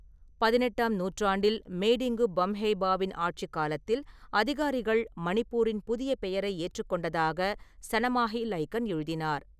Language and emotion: Tamil, neutral